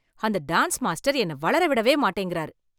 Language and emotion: Tamil, angry